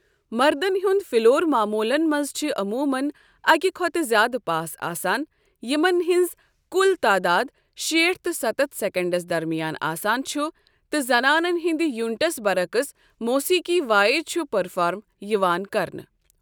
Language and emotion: Kashmiri, neutral